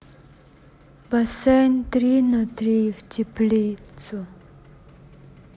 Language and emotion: Russian, sad